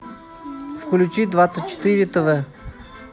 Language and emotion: Russian, neutral